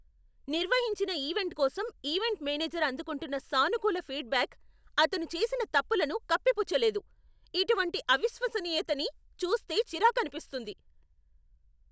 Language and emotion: Telugu, angry